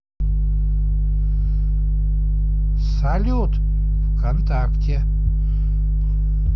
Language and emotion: Russian, positive